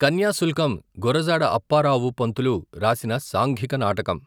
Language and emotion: Telugu, neutral